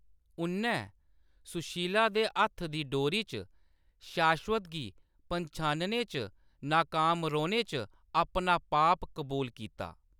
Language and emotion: Dogri, neutral